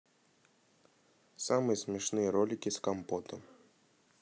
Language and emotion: Russian, neutral